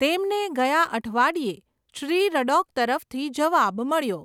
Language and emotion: Gujarati, neutral